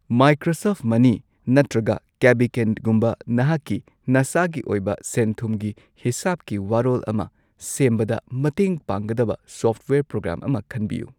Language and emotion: Manipuri, neutral